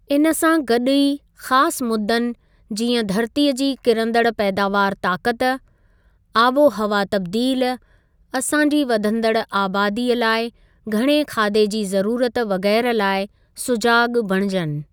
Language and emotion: Sindhi, neutral